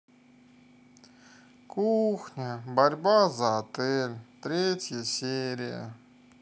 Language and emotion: Russian, sad